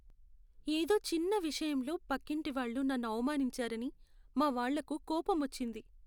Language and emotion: Telugu, sad